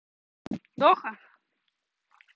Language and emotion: Russian, neutral